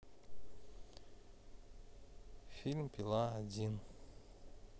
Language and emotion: Russian, neutral